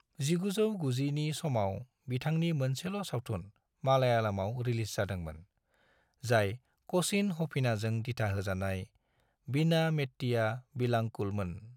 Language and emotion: Bodo, neutral